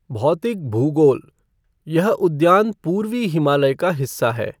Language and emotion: Hindi, neutral